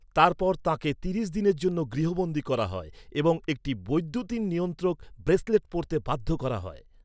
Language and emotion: Bengali, neutral